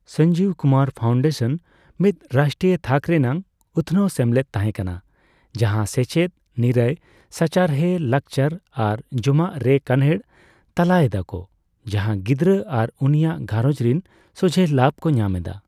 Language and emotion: Santali, neutral